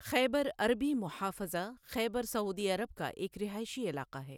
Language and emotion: Urdu, neutral